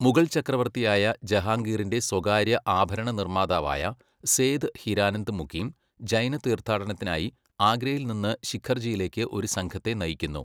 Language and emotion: Malayalam, neutral